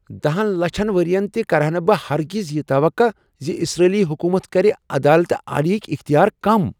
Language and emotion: Kashmiri, surprised